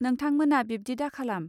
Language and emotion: Bodo, neutral